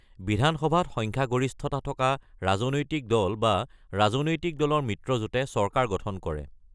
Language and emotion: Assamese, neutral